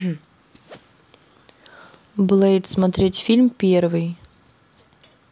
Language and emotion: Russian, neutral